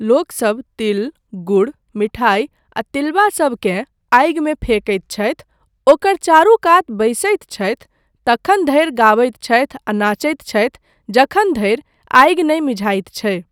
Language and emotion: Maithili, neutral